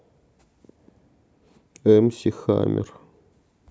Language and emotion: Russian, sad